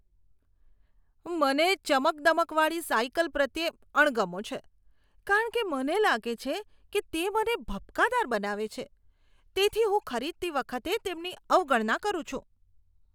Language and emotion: Gujarati, disgusted